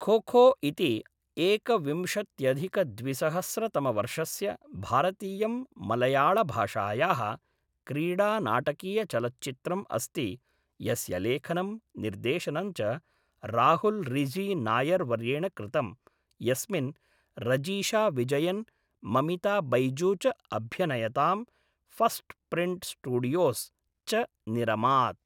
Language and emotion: Sanskrit, neutral